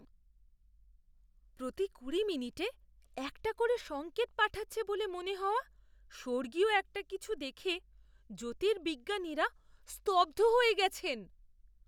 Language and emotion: Bengali, surprised